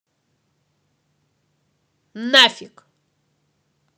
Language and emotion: Russian, angry